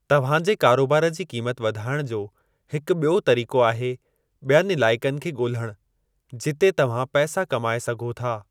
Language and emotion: Sindhi, neutral